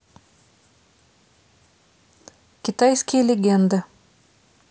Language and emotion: Russian, neutral